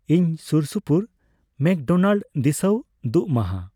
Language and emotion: Santali, neutral